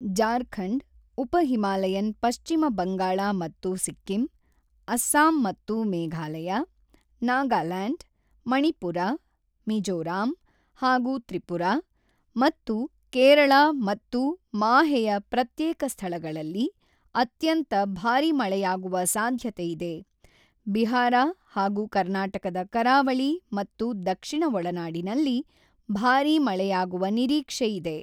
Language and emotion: Kannada, neutral